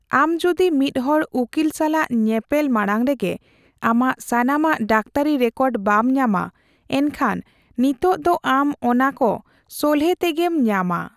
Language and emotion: Santali, neutral